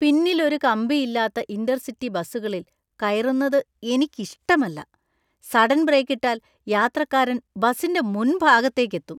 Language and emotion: Malayalam, disgusted